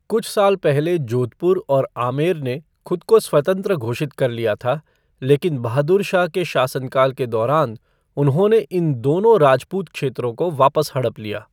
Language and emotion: Hindi, neutral